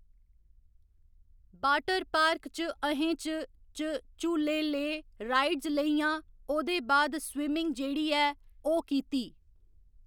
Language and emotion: Dogri, neutral